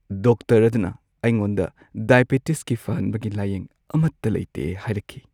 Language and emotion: Manipuri, sad